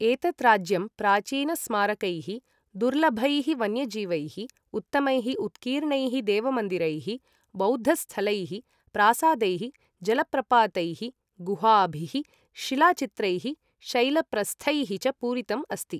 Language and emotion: Sanskrit, neutral